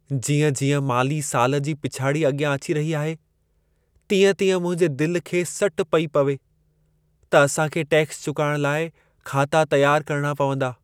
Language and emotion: Sindhi, sad